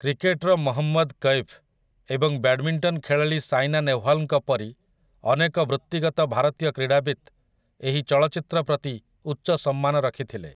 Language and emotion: Odia, neutral